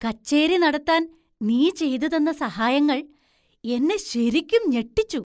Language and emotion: Malayalam, surprised